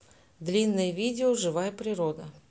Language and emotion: Russian, neutral